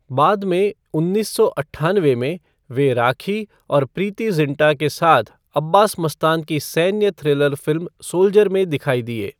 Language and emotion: Hindi, neutral